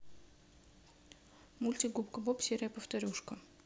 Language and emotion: Russian, neutral